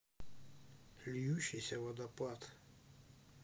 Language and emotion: Russian, neutral